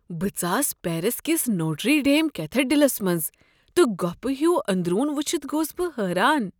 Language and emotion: Kashmiri, surprised